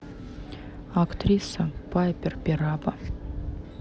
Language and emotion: Russian, neutral